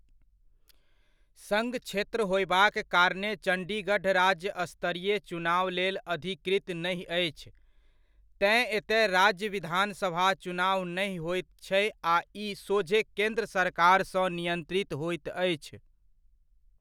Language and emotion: Maithili, neutral